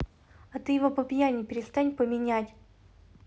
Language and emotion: Russian, angry